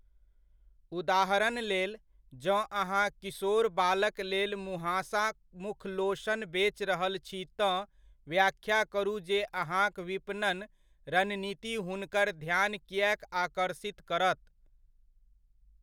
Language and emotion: Maithili, neutral